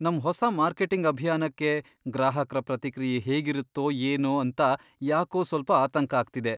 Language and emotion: Kannada, fearful